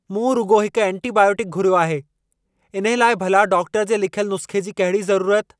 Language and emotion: Sindhi, angry